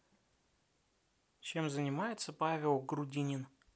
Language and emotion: Russian, neutral